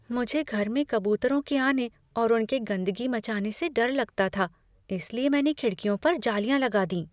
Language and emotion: Hindi, fearful